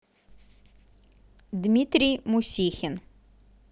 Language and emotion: Russian, neutral